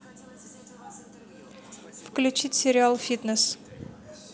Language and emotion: Russian, neutral